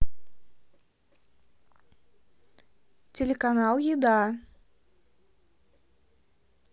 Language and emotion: Russian, neutral